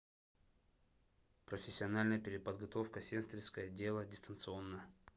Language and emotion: Russian, neutral